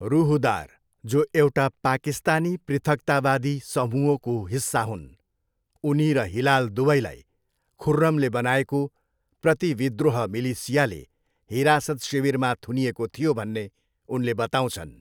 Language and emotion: Nepali, neutral